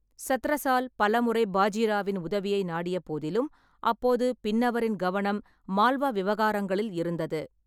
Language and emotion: Tamil, neutral